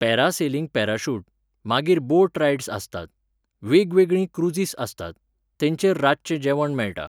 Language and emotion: Goan Konkani, neutral